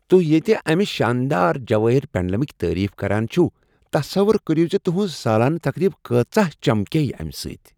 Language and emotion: Kashmiri, happy